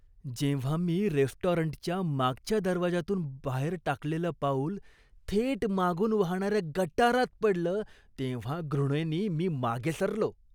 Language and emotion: Marathi, disgusted